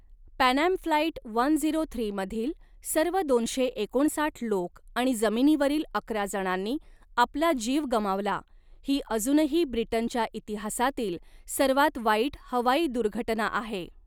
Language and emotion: Marathi, neutral